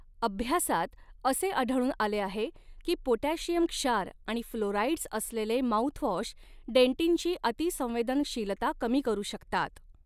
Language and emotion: Marathi, neutral